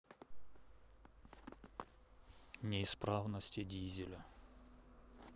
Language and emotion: Russian, neutral